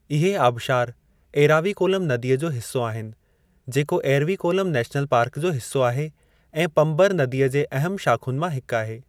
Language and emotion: Sindhi, neutral